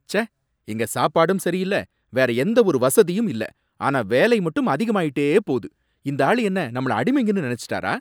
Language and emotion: Tamil, angry